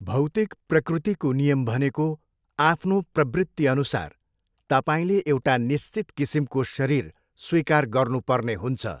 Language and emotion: Nepali, neutral